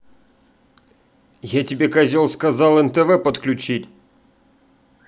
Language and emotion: Russian, angry